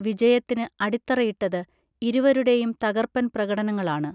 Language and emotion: Malayalam, neutral